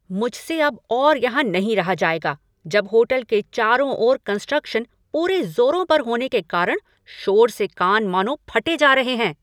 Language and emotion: Hindi, angry